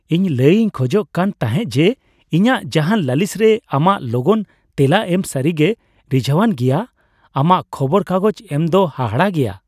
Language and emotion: Santali, happy